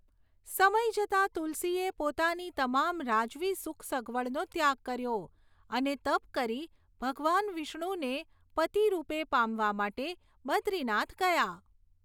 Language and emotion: Gujarati, neutral